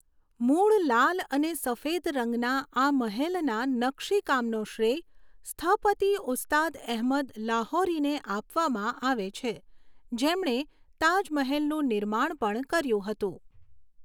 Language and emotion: Gujarati, neutral